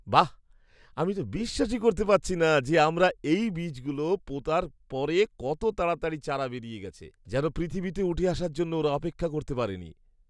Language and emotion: Bengali, surprised